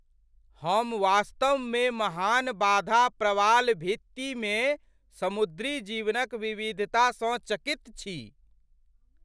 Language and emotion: Maithili, surprised